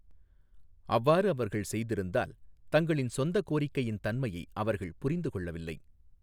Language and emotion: Tamil, neutral